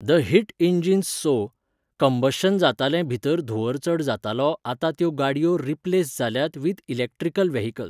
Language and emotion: Goan Konkani, neutral